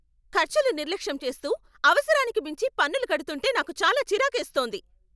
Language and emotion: Telugu, angry